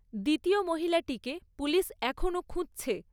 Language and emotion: Bengali, neutral